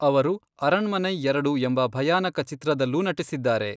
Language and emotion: Kannada, neutral